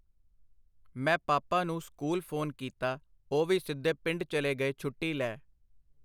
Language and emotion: Punjabi, neutral